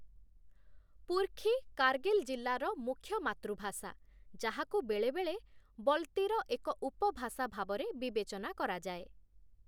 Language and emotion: Odia, neutral